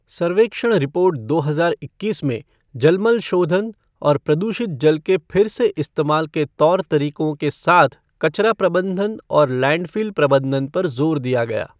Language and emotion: Hindi, neutral